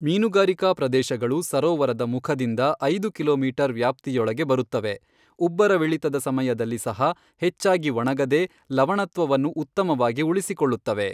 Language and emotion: Kannada, neutral